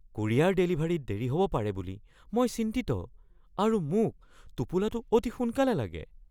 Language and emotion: Assamese, fearful